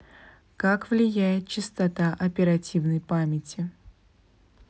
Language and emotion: Russian, neutral